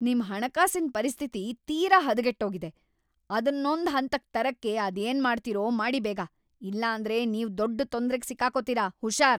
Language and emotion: Kannada, angry